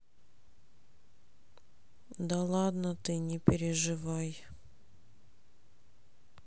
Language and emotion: Russian, sad